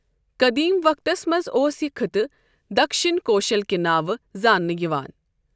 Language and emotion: Kashmiri, neutral